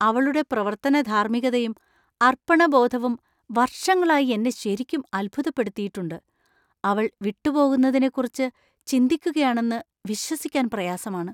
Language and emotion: Malayalam, surprised